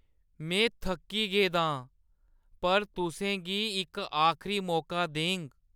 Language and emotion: Dogri, sad